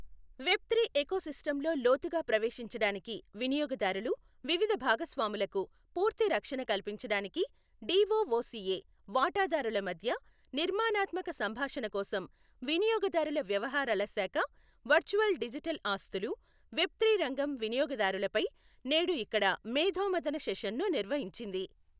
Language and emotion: Telugu, neutral